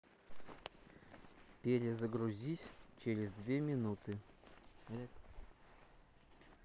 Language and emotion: Russian, neutral